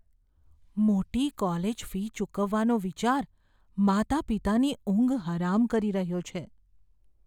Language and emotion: Gujarati, fearful